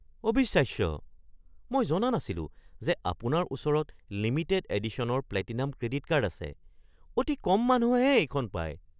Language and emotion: Assamese, surprised